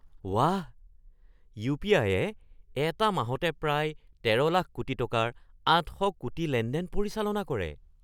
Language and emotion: Assamese, surprised